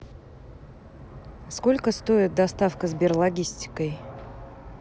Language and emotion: Russian, neutral